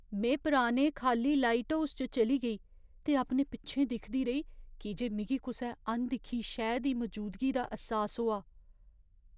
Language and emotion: Dogri, fearful